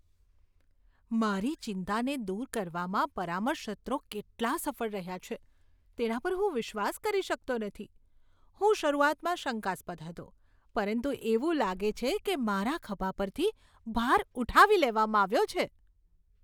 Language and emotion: Gujarati, surprised